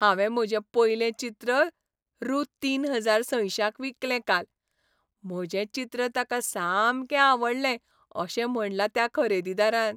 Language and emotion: Goan Konkani, happy